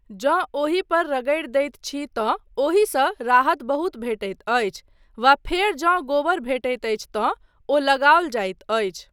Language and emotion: Maithili, neutral